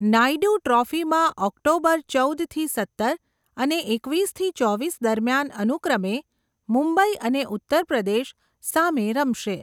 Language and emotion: Gujarati, neutral